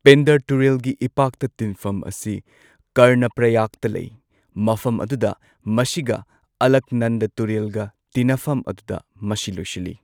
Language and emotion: Manipuri, neutral